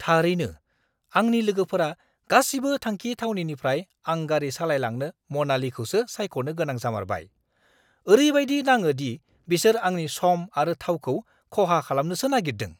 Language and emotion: Bodo, angry